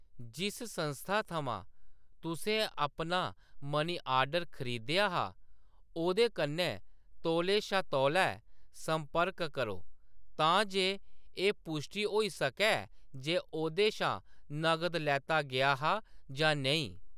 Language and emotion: Dogri, neutral